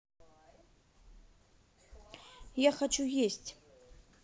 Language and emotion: Russian, neutral